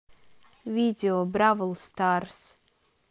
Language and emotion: Russian, neutral